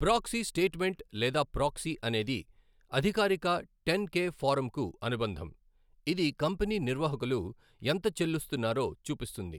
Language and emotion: Telugu, neutral